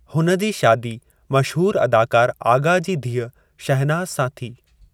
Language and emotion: Sindhi, neutral